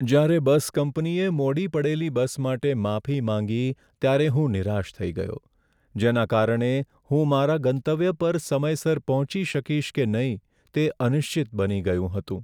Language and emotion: Gujarati, sad